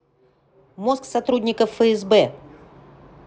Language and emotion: Russian, neutral